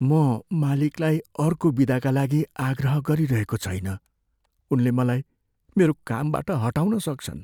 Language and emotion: Nepali, fearful